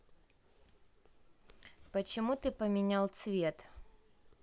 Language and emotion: Russian, neutral